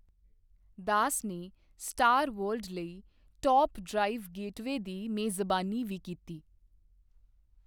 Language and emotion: Punjabi, neutral